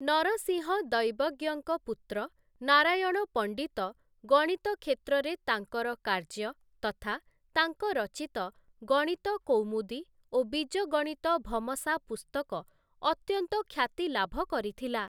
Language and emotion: Odia, neutral